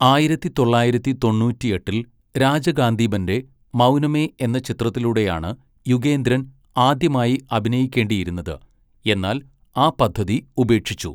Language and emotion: Malayalam, neutral